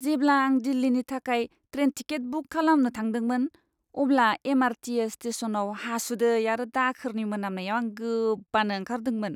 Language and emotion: Bodo, disgusted